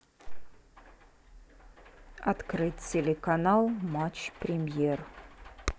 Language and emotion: Russian, neutral